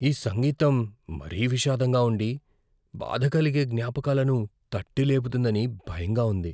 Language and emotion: Telugu, fearful